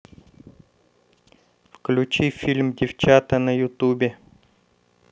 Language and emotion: Russian, neutral